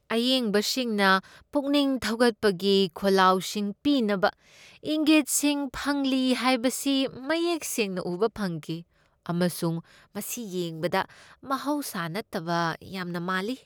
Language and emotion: Manipuri, disgusted